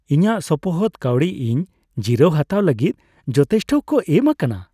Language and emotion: Santali, happy